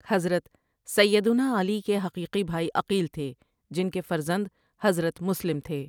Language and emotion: Urdu, neutral